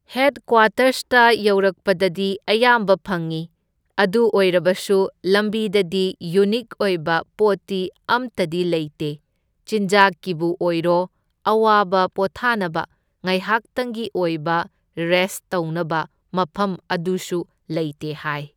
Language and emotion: Manipuri, neutral